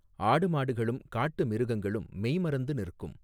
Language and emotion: Tamil, neutral